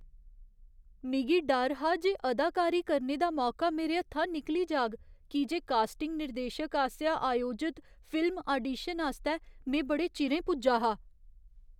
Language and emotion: Dogri, fearful